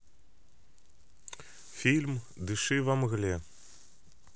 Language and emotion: Russian, neutral